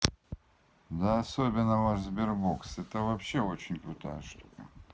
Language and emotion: Russian, neutral